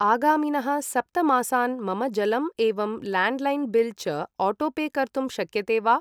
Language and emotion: Sanskrit, neutral